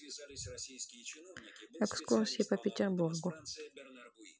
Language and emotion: Russian, neutral